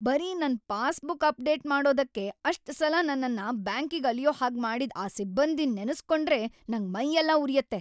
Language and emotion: Kannada, angry